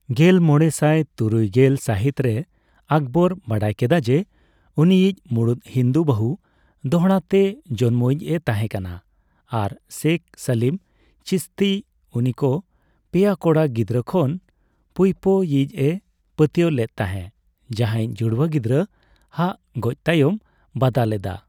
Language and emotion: Santali, neutral